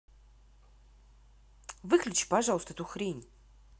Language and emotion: Russian, angry